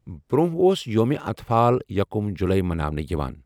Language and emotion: Kashmiri, neutral